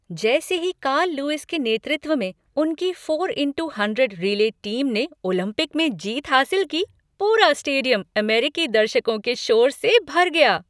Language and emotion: Hindi, happy